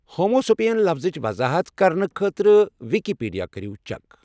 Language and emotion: Kashmiri, neutral